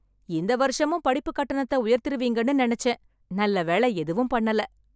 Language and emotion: Tamil, happy